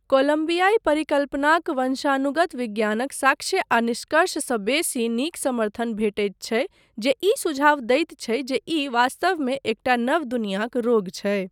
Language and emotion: Maithili, neutral